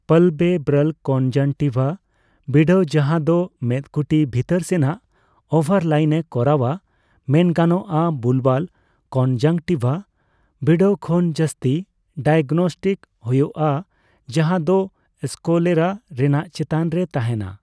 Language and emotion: Santali, neutral